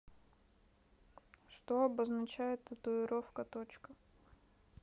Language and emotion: Russian, neutral